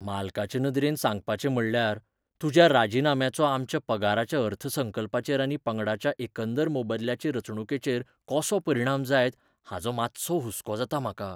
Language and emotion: Goan Konkani, fearful